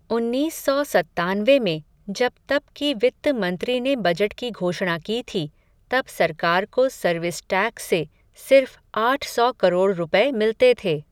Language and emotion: Hindi, neutral